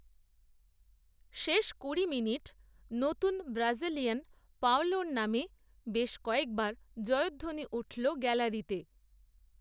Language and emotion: Bengali, neutral